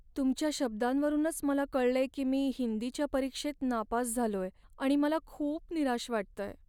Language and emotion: Marathi, sad